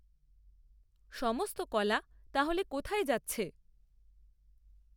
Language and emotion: Bengali, neutral